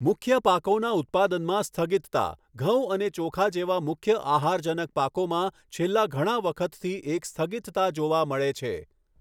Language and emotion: Gujarati, neutral